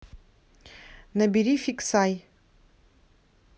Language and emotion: Russian, neutral